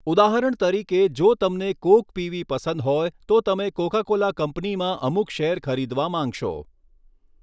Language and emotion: Gujarati, neutral